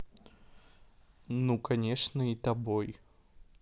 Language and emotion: Russian, neutral